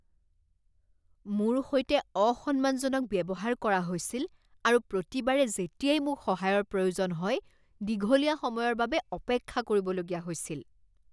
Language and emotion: Assamese, disgusted